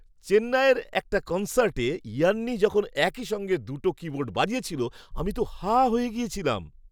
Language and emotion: Bengali, surprised